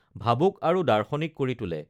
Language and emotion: Assamese, neutral